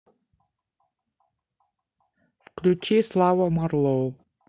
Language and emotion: Russian, neutral